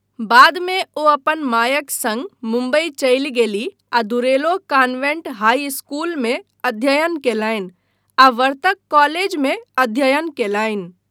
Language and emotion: Maithili, neutral